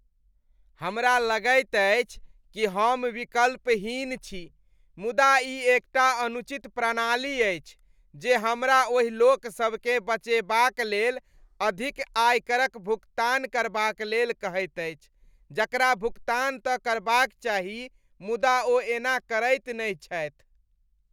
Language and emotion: Maithili, disgusted